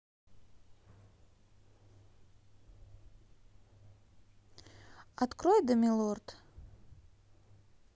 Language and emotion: Russian, positive